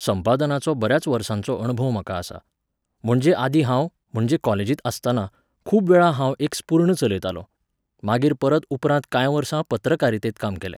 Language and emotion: Goan Konkani, neutral